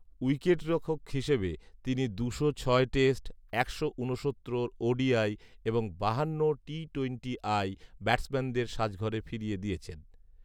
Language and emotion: Bengali, neutral